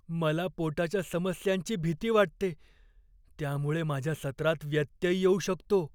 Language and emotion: Marathi, fearful